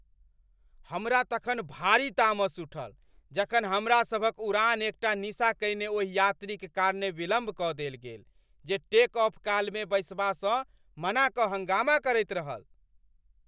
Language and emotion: Maithili, angry